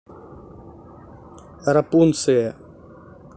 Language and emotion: Russian, neutral